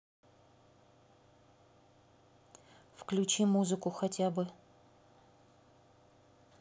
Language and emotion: Russian, neutral